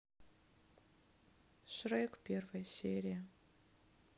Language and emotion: Russian, sad